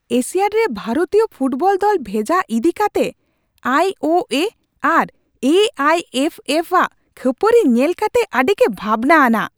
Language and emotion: Santali, angry